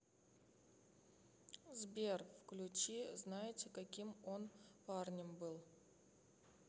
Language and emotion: Russian, neutral